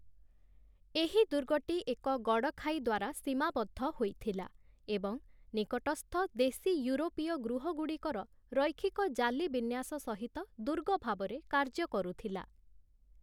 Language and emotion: Odia, neutral